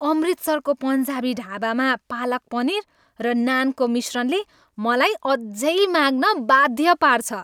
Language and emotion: Nepali, happy